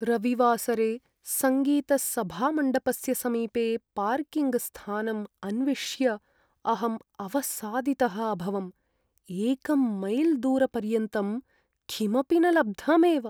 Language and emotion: Sanskrit, sad